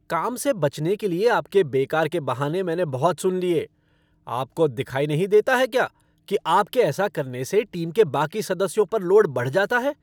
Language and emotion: Hindi, angry